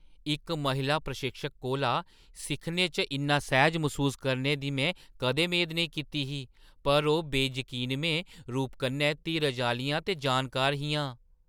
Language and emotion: Dogri, surprised